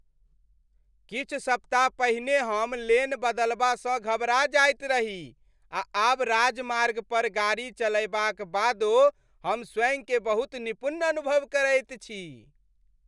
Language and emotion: Maithili, happy